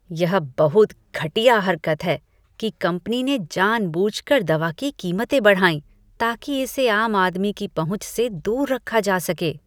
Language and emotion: Hindi, disgusted